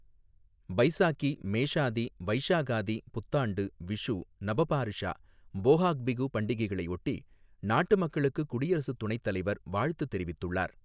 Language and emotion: Tamil, neutral